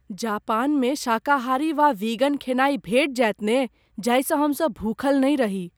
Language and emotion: Maithili, fearful